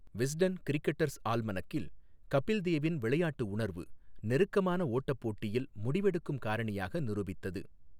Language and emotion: Tamil, neutral